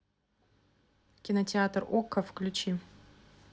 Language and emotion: Russian, neutral